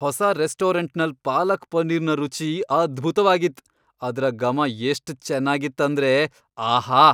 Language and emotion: Kannada, happy